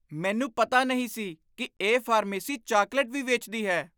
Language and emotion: Punjabi, surprised